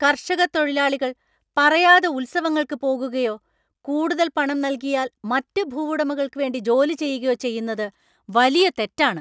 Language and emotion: Malayalam, angry